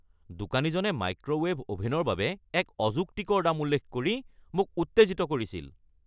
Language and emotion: Assamese, angry